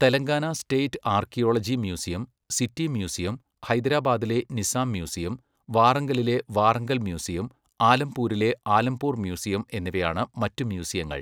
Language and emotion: Malayalam, neutral